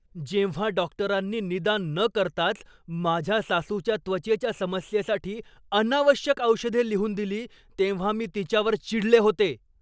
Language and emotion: Marathi, angry